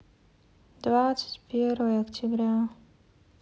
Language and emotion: Russian, sad